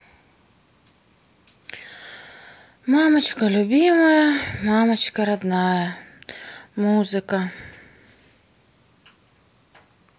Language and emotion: Russian, sad